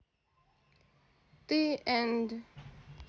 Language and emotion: Russian, neutral